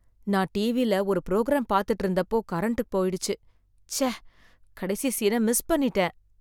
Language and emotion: Tamil, sad